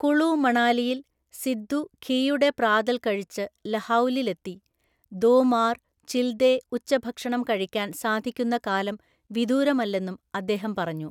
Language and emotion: Malayalam, neutral